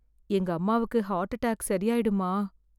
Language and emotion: Tamil, fearful